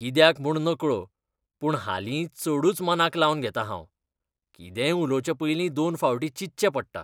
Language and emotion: Goan Konkani, disgusted